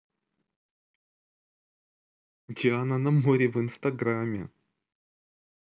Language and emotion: Russian, positive